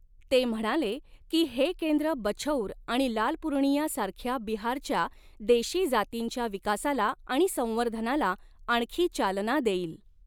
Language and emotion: Marathi, neutral